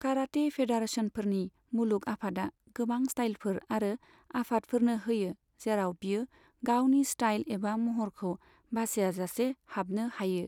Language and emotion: Bodo, neutral